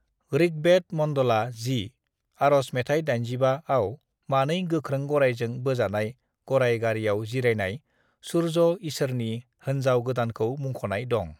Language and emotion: Bodo, neutral